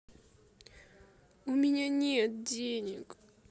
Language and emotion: Russian, sad